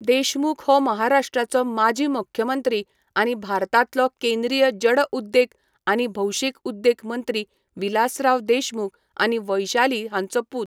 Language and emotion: Goan Konkani, neutral